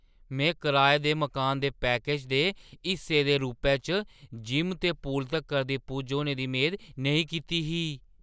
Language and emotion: Dogri, surprised